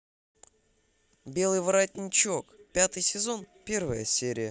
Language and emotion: Russian, positive